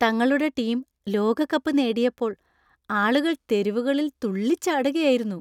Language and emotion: Malayalam, happy